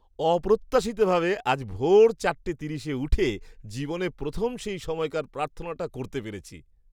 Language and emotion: Bengali, surprised